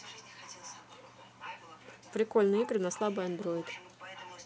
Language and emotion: Russian, neutral